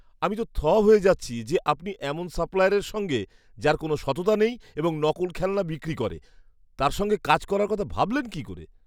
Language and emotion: Bengali, disgusted